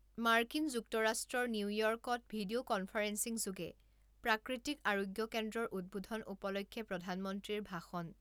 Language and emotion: Assamese, neutral